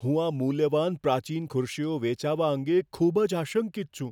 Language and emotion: Gujarati, fearful